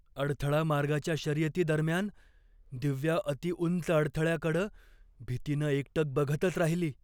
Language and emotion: Marathi, fearful